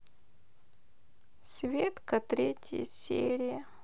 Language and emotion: Russian, sad